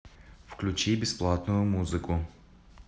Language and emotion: Russian, neutral